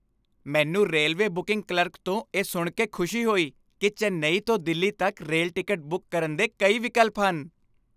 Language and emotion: Punjabi, happy